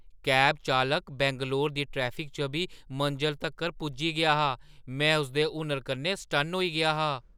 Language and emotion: Dogri, surprised